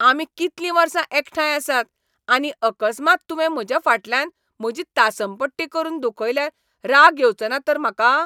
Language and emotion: Goan Konkani, angry